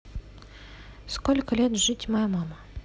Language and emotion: Russian, neutral